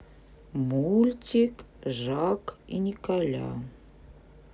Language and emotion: Russian, neutral